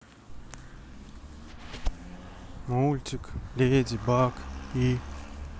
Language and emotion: Russian, sad